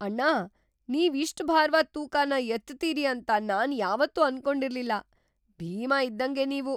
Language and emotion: Kannada, surprised